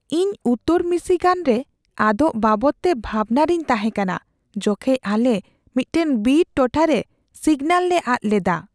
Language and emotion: Santali, fearful